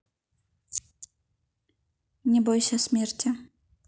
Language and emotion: Russian, neutral